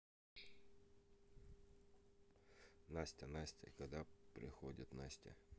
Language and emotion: Russian, neutral